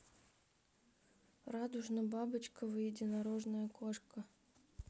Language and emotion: Russian, sad